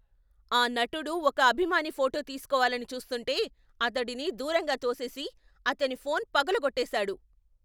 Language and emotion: Telugu, angry